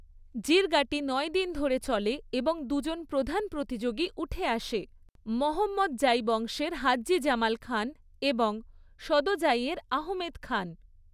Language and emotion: Bengali, neutral